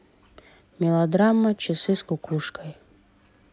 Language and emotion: Russian, neutral